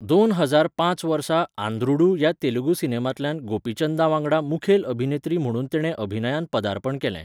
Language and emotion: Goan Konkani, neutral